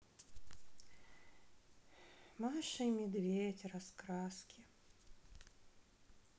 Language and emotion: Russian, sad